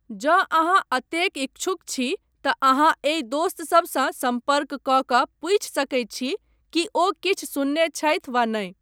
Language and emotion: Maithili, neutral